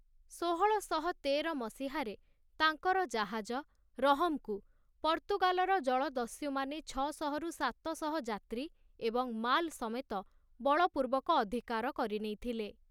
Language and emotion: Odia, neutral